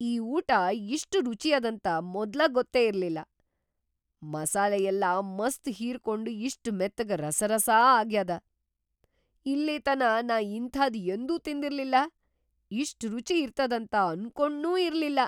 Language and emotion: Kannada, surprised